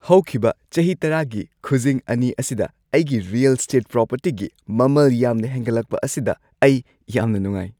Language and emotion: Manipuri, happy